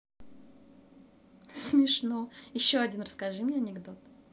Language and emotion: Russian, positive